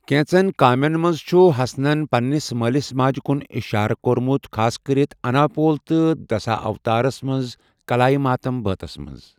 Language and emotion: Kashmiri, neutral